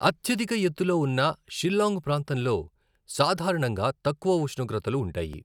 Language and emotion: Telugu, neutral